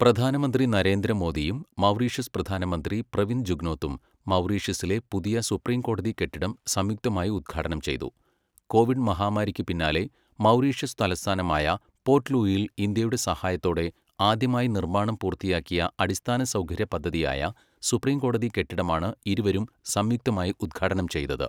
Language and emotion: Malayalam, neutral